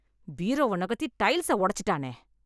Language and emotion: Tamil, angry